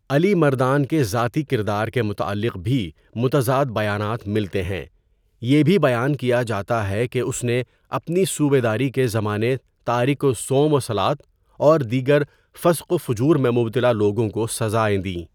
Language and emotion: Urdu, neutral